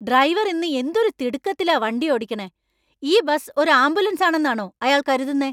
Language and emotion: Malayalam, angry